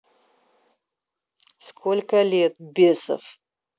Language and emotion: Russian, angry